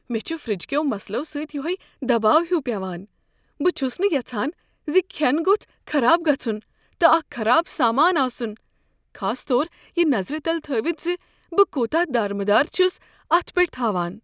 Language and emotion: Kashmiri, fearful